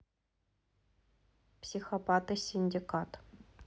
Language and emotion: Russian, neutral